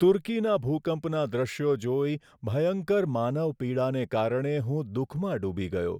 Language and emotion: Gujarati, sad